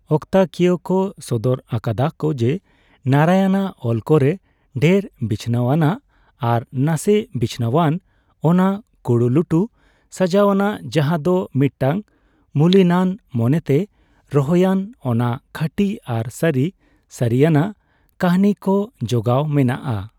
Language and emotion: Santali, neutral